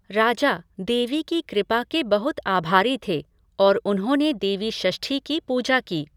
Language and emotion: Hindi, neutral